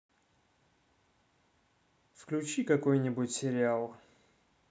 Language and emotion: Russian, neutral